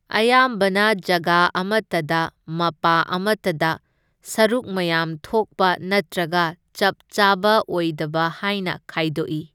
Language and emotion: Manipuri, neutral